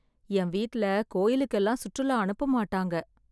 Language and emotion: Tamil, sad